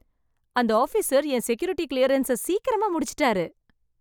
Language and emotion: Tamil, happy